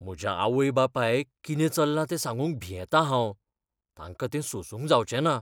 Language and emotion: Goan Konkani, fearful